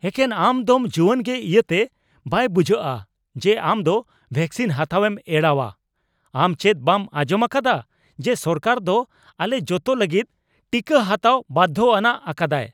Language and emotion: Santali, angry